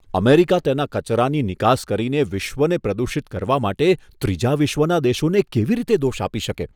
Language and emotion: Gujarati, disgusted